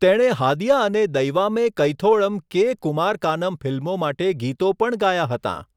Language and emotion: Gujarati, neutral